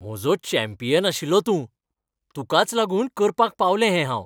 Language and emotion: Goan Konkani, happy